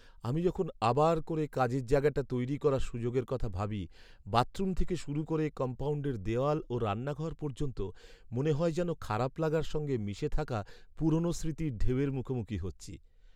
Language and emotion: Bengali, sad